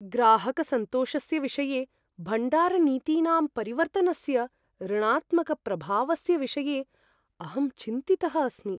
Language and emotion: Sanskrit, fearful